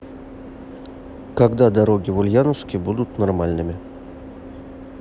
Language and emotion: Russian, neutral